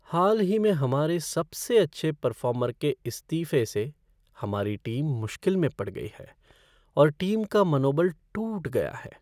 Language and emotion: Hindi, sad